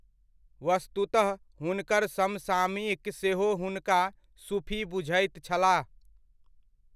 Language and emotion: Maithili, neutral